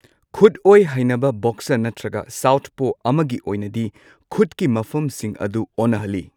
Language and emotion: Manipuri, neutral